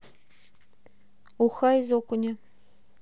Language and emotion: Russian, neutral